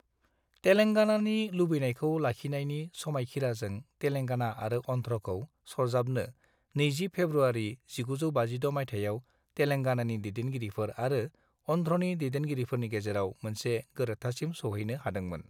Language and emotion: Bodo, neutral